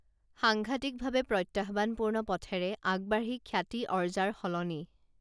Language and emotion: Assamese, neutral